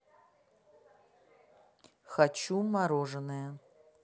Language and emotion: Russian, neutral